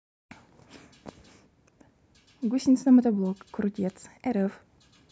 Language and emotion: Russian, neutral